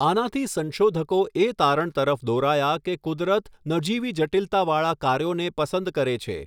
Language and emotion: Gujarati, neutral